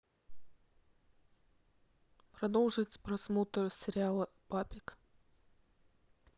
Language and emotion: Russian, neutral